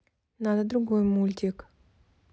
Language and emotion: Russian, neutral